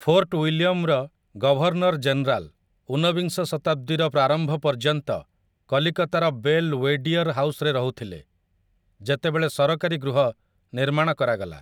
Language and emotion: Odia, neutral